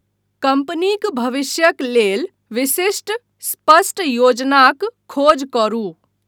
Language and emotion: Maithili, neutral